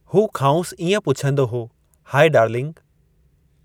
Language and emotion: Sindhi, neutral